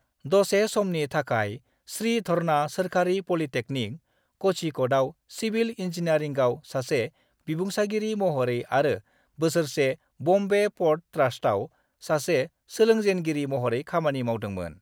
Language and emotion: Bodo, neutral